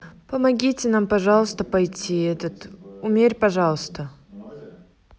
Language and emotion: Russian, neutral